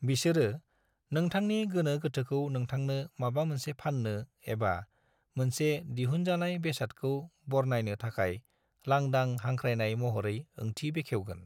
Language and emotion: Bodo, neutral